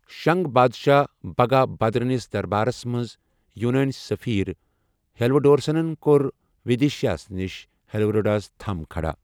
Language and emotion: Kashmiri, neutral